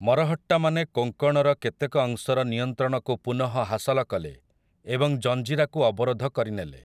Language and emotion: Odia, neutral